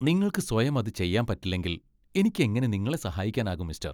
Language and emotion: Malayalam, disgusted